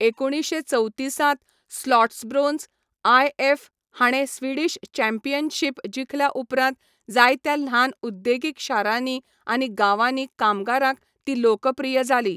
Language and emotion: Goan Konkani, neutral